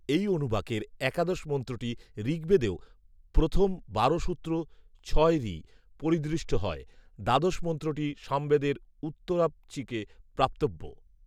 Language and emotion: Bengali, neutral